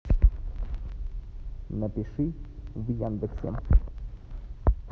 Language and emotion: Russian, neutral